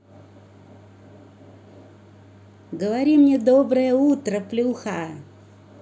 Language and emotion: Russian, positive